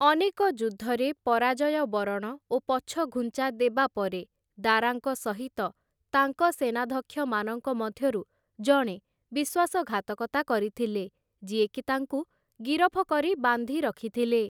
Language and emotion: Odia, neutral